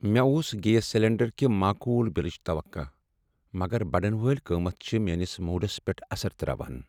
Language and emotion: Kashmiri, sad